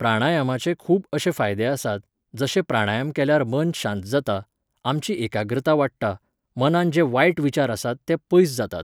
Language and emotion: Goan Konkani, neutral